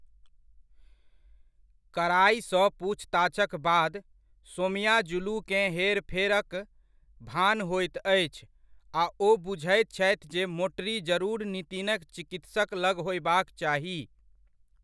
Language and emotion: Maithili, neutral